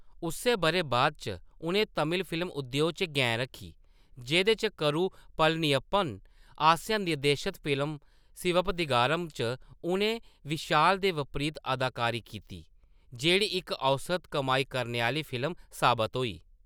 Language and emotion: Dogri, neutral